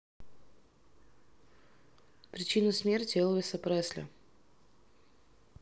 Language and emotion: Russian, neutral